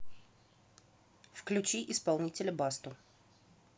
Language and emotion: Russian, neutral